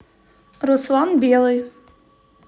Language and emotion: Russian, neutral